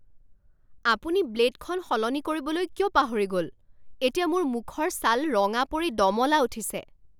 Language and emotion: Assamese, angry